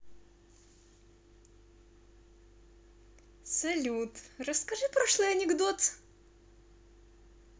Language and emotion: Russian, positive